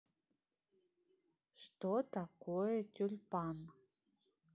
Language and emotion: Russian, neutral